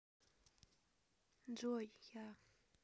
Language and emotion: Russian, sad